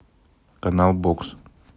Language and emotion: Russian, neutral